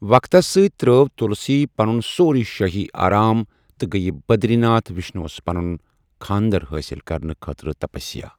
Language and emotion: Kashmiri, neutral